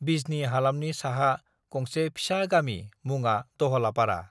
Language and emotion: Bodo, neutral